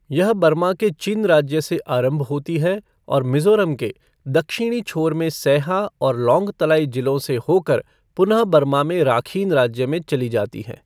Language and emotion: Hindi, neutral